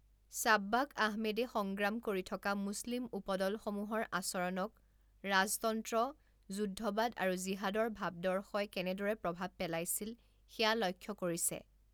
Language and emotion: Assamese, neutral